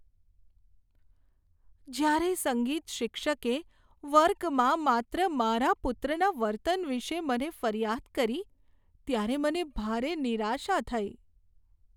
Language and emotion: Gujarati, sad